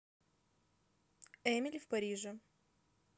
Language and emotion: Russian, neutral